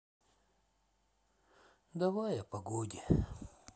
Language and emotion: Russian, sad